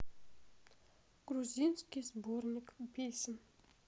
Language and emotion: Russian, sad